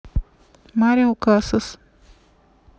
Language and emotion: Russian, neutral